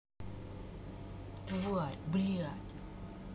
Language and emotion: Russian, angry